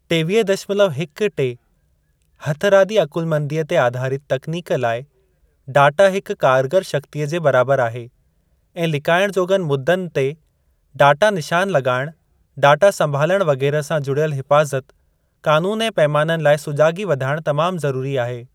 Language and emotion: Sindhi, neutral